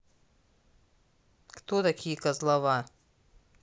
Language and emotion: Russian, angry